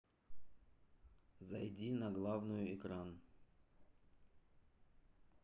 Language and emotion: Russian, neutral